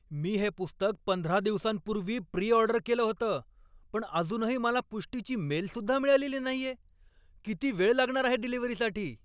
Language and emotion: Marathi, angry